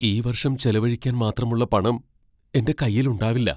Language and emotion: Malayalam, fearful